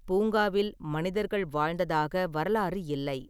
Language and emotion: Tamil, neutral